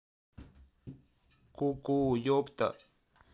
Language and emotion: Russian, neutral